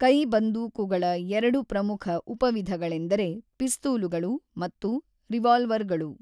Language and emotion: Kannada, neutral